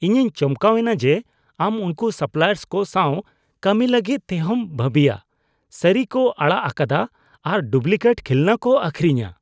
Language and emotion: Santali, disgusted